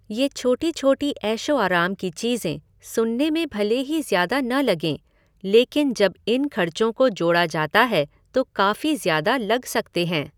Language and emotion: Hindi, neutral